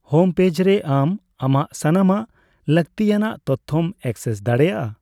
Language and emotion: Santali, neutral